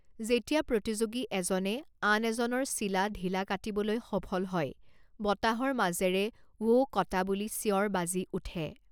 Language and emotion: Assamese, neutral